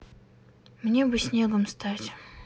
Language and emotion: Russian, sad